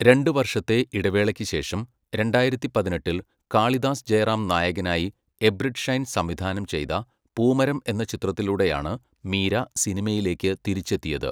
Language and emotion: Malayalam, neutral